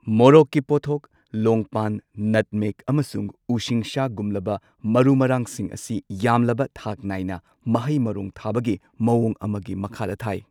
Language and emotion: Manipuri, neutral